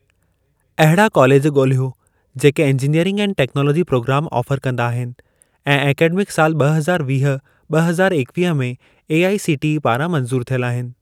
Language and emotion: Sindhi, neutral